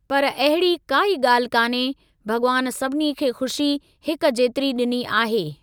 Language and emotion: Sindhi, neutral